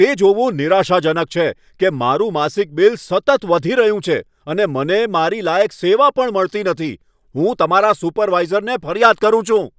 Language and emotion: Gujarati, angry